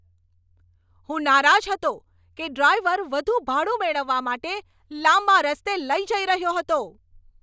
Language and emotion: Gujarati, angry